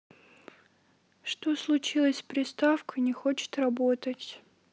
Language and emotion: Russian, sad